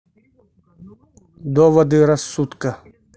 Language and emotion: Russian, neutral